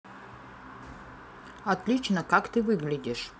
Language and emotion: Russian, neutral